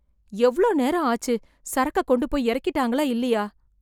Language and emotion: Tamil, fearful